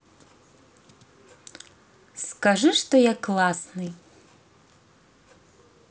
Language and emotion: Russian, positive